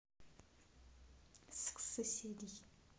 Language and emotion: Russian, neutral